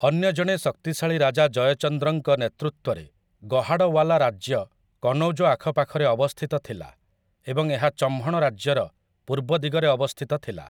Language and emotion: Odia, neutral